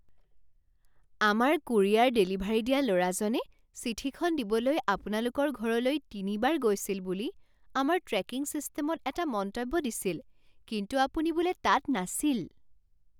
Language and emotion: Assamese, surprised